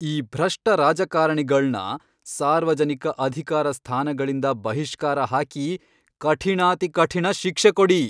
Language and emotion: Kannada, angry